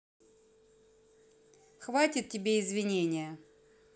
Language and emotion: Russian, neutral